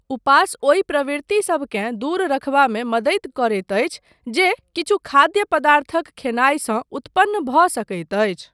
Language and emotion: Maithili, neutral